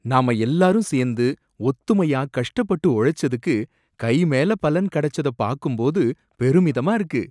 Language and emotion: Tamil, surprised